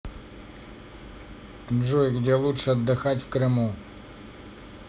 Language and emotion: Russian, neutral